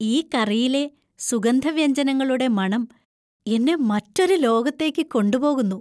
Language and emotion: Malayalam, happy